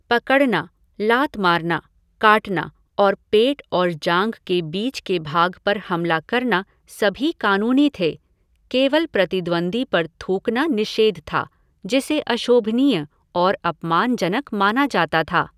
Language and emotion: Hindi, neutral